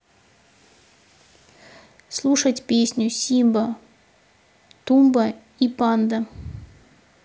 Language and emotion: Russian, neutral